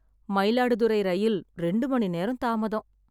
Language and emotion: Tamil, sad